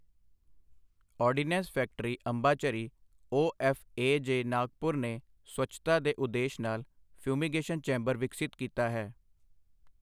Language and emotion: Punjabi, neutral